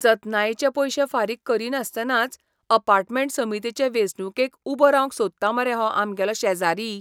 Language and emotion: Goan Konkani, disgusted